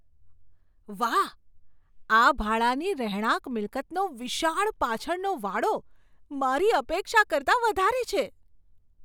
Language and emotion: Gujarati, surprised